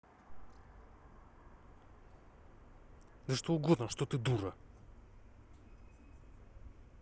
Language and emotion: Russian, angry